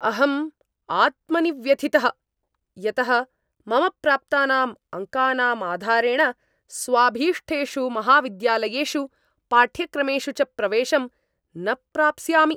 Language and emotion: Sanskrit, angry